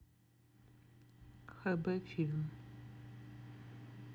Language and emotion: Russian, neutral